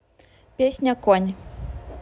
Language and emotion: Russian, neutral